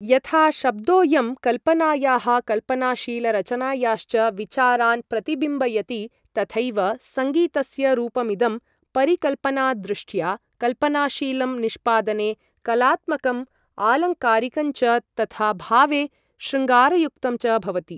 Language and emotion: Sanskrit, neutral